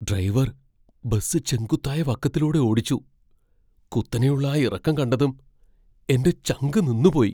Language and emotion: Malayalam, fearful